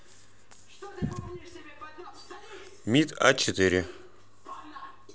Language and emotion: Russian, neutral